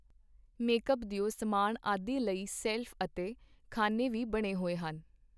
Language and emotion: Punjabi, neutral